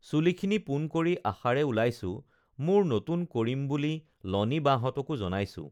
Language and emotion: Assamese, neutral